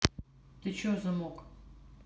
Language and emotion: Russian, neutral